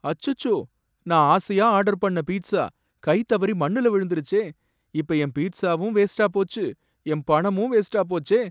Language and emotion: Tamil, sad